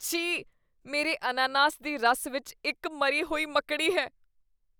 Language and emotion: Punjabi, disgusted